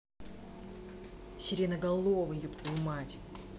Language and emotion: Russian, angry